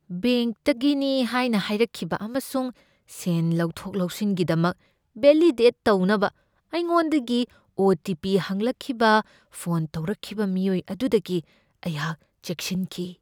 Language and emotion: Manipuri, fearful